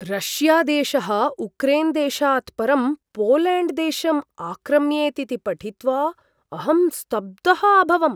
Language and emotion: Sanskrit, surprised